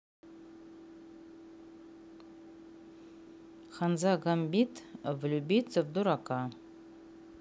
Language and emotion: Russian, neutral